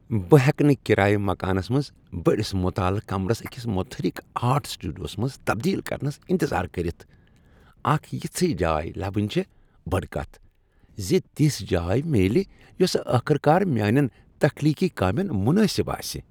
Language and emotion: Kashmiri, happy